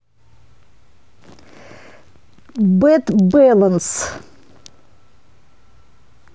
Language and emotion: Russian, neutral